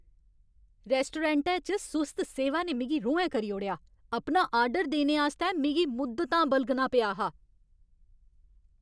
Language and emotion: Dogri, angry